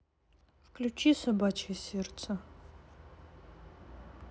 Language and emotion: Russian, sad